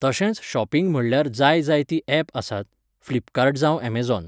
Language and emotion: Goan Konkani, neutral